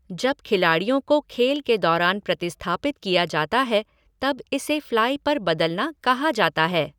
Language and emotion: Hindi, neutral